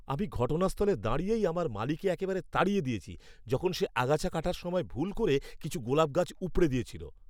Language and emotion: Bengali, angry